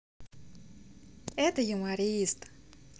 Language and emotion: Russian, positive